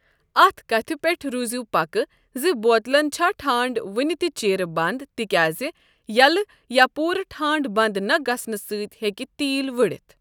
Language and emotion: Kashmiri, neutral